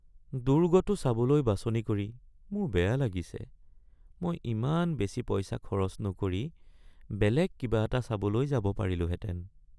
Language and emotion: Assamese, sad